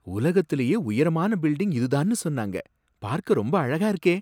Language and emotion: Tamil, surprised